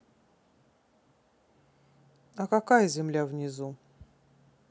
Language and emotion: Russian, neutral